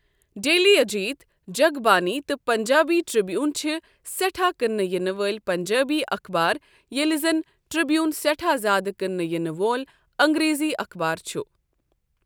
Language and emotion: Kashmiri, neutral